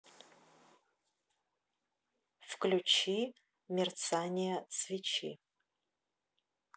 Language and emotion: Russian, neutral